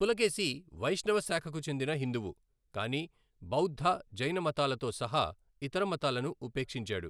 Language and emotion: Telugu, neutral